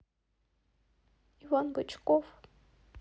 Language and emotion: Russian, sad